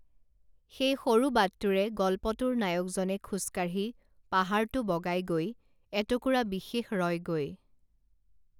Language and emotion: Assamese, neutral